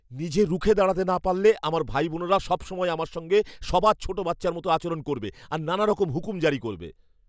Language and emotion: Bengali, fearful